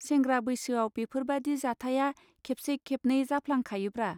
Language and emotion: Bodo, neutral